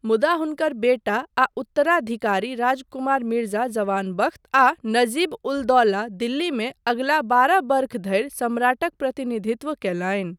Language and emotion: Maithili, neutral